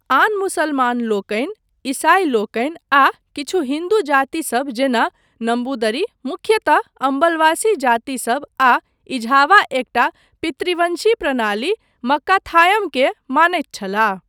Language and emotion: Maithili, neutral